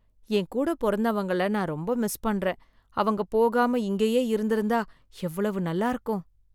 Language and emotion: Tamil, sad